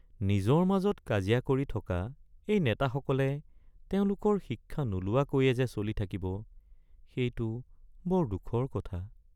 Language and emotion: Assamese, sad